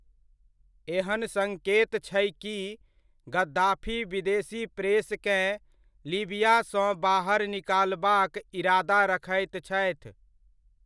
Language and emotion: Maithili, neutral